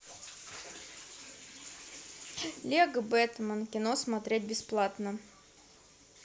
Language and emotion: Russian, neutral